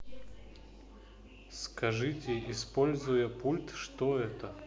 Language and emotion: Russian, neutral